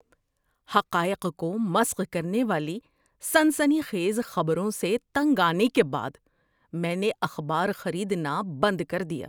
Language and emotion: Urdu, disgusted